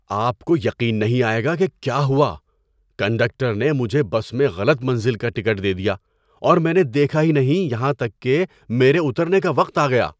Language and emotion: Urdu, surprised